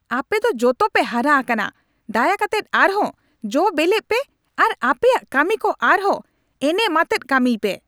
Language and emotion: Santali, angry